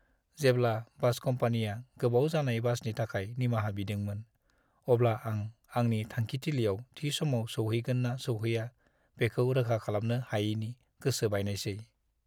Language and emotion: Bodo, sad